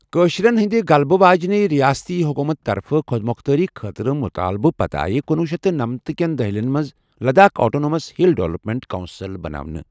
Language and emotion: Kashmiri, neutral